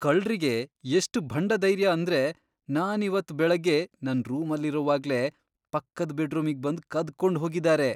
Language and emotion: Kannada, disgusted